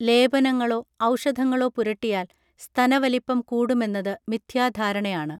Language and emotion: Malayalam, neutral